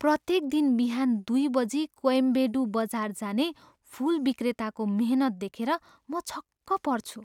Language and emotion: Nepali, surprised